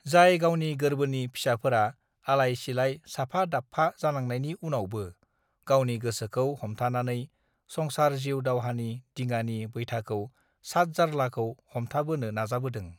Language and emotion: Bodo, neutral